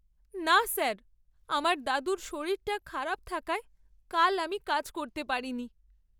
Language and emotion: Bengali, sad